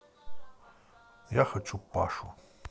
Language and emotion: Russian, neutral